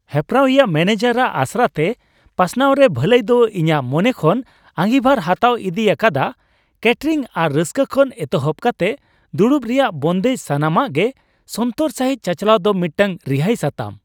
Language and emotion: Santali, happy